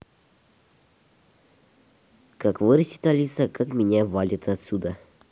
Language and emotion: Russian, neutral